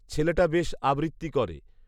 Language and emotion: Bengali, neutral